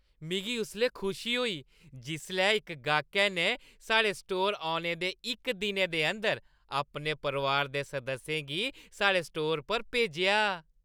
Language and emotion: Dogri, happy